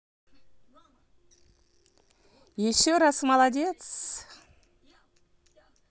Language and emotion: Russian, positive